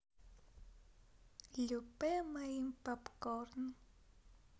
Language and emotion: Russian, positive